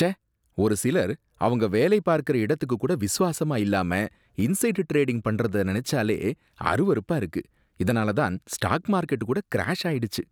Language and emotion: Tamil, disgusted